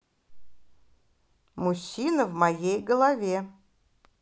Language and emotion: Russian, positive